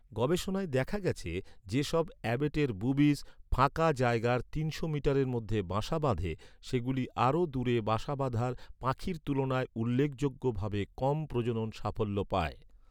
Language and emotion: Bengali, neutral